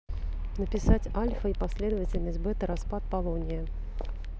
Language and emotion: Russian, neutral